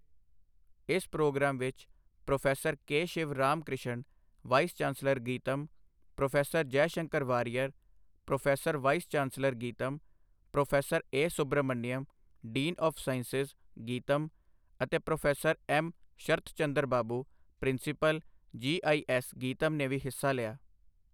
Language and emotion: Punjabi, neutral